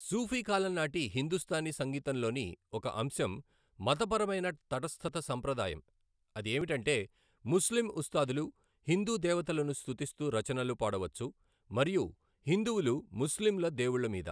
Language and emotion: Telugu, neutral